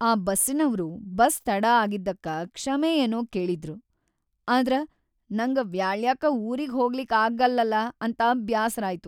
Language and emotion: Kannada, sad